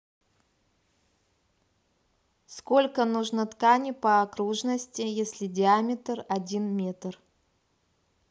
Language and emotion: Russian, neutral